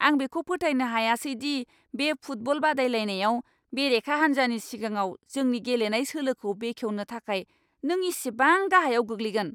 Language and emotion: Bodo, angry